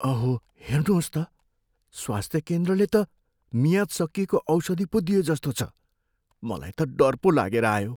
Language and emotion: Nepali, fearful